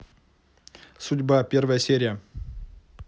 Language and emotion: Russian, neutral